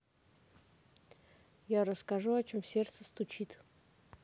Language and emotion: Russian, neutral